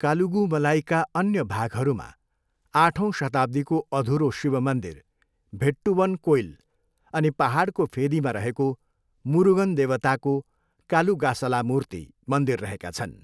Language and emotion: Nepali, neutral